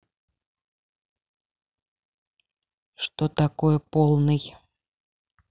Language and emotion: Russian, neutral